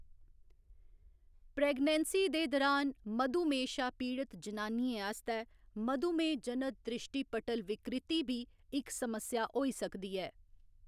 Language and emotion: Dogri, neutral